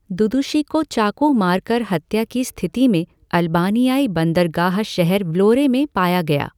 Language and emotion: Hindi, neutral